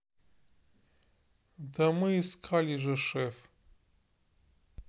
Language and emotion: Russian, neutral